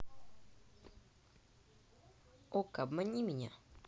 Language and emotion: Russian, neutral